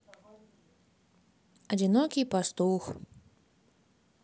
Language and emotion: Russian, sad